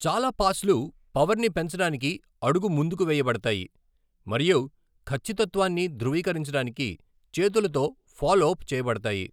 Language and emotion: Telugu, neutral